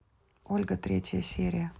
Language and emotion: Russian, neutral